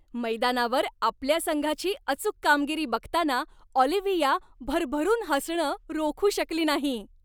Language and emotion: Marathi, happy